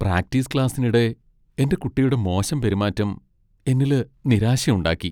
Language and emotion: Malayalam, sad